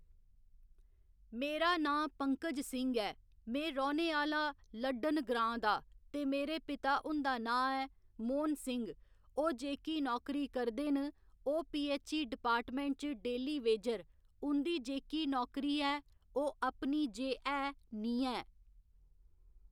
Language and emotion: Dogri, neutral